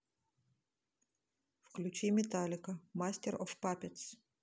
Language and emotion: Russian, neutral